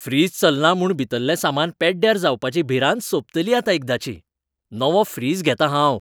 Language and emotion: Goan Konkani, happy